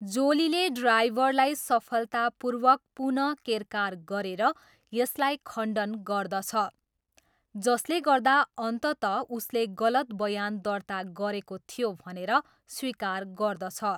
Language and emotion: Nepali, neutral